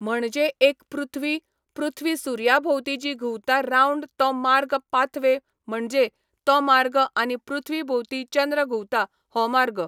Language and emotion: Goan Konkani, neutral